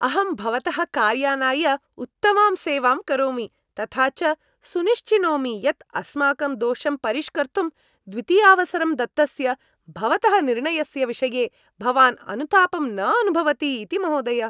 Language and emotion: Sanskrit, happy